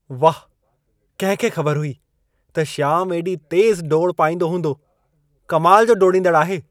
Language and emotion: Sindhi, surprised